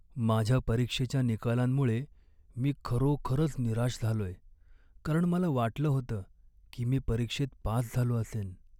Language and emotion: Marathi, sad